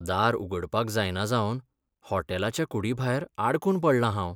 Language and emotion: Goan Konkani, sad